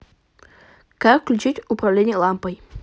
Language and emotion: Russian, neutral